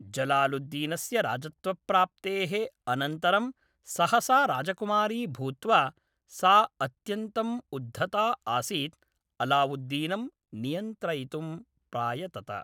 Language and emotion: Sanskrit, neutral